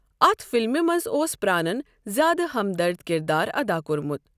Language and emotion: Kashmiri, neutral